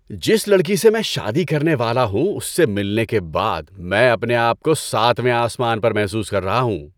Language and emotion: Urdu, happy